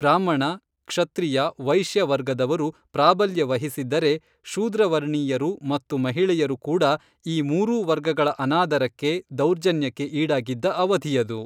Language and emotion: Kannada, neutral